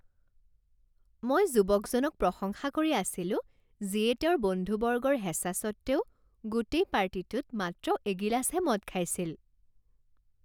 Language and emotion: Assamese, happy